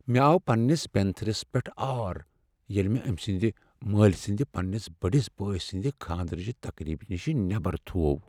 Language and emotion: Kashmiri, sad